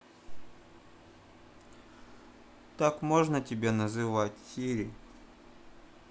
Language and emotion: Russian, neutral